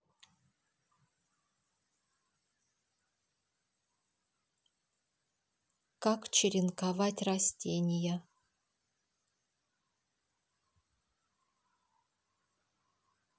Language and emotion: Russian, neutral